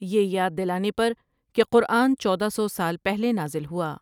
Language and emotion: Urdu, neutral